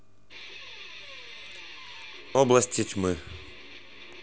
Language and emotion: Russian, neutral